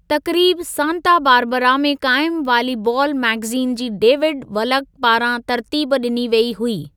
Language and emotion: Sindhi, neutral